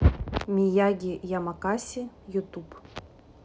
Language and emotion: Russian, neutral